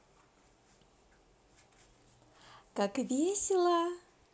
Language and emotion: Russian, positive